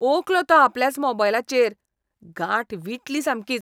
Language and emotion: Goan Konkani, disgusted